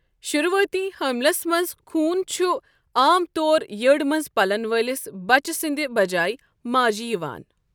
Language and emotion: Kashmiri, neutral